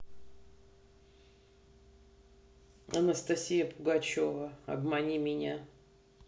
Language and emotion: Russian, neutral